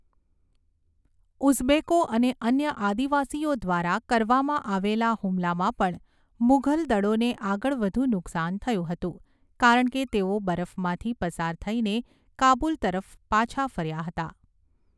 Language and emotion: Gujarati, neutral